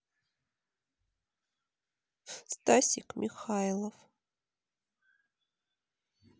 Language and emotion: Russian, sad